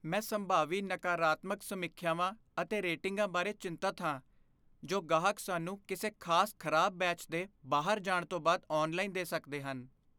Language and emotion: Punjabi, fearful